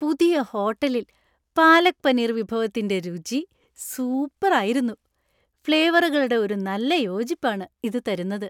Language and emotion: Malayalam, happy